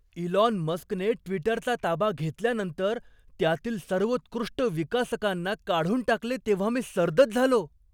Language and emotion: Marathi, surprised